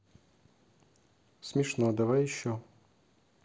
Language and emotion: Russian, neutral